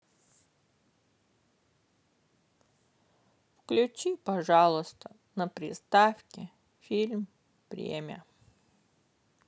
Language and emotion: Russian, sad